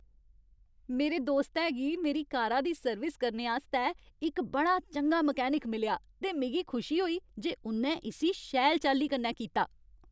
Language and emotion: Dogri, happy